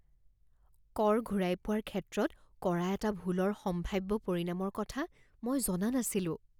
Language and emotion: Assamese, fearful